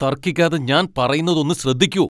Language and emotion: Malayalam, angry